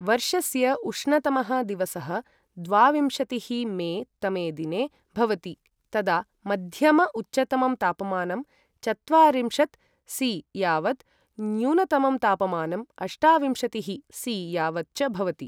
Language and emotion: Sanskrit, neutral